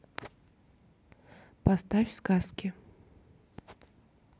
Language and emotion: Russian, neutral